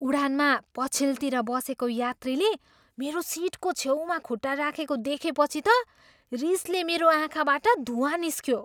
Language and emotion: Nepali, surprised